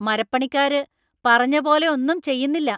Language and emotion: Malayalam, angry